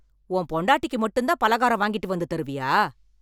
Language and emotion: Tamil, angry